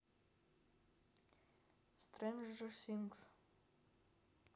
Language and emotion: Russian, neutral